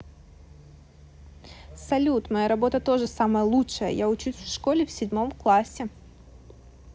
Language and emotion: Russian, positive